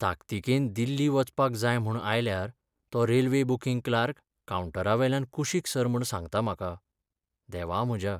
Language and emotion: Goan Konkani, sad